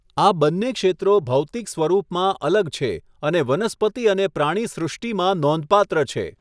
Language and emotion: Gujarati, neutral